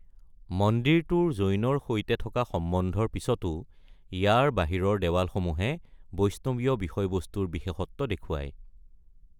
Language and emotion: Assamese, neutral